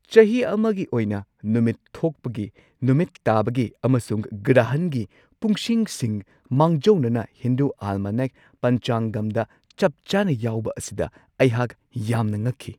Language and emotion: Manipuri, surprised